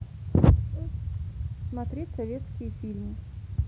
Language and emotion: Russian, neutral